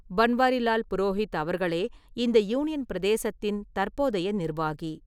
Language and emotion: Tamil, neutral